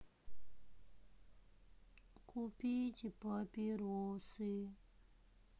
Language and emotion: Russian, sad